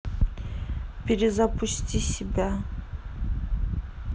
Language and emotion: Russian, neutral